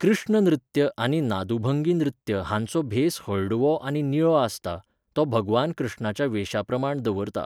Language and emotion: Goan Konkani, neutral